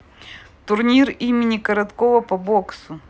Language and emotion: Russian, neutral